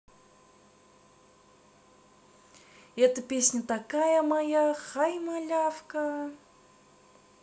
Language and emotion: Russian, positive